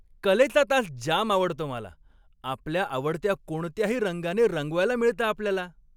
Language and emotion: Marathi, happy